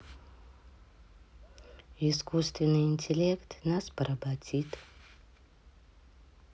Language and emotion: Russian, neutral